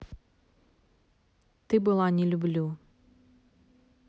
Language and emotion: Russian, neutral